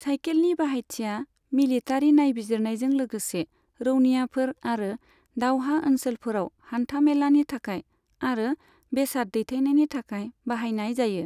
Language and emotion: Bodo, neutral